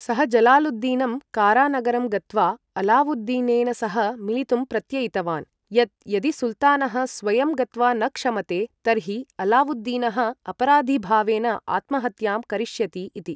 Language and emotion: Sanskrit, neutral